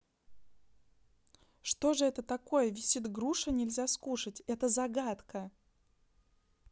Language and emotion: Russian, neutral